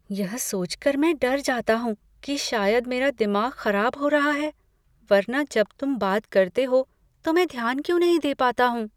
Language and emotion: Hindi, fearful